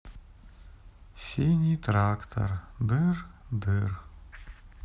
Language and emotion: Russian, sad